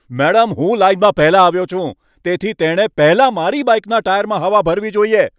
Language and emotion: Gujarati, angry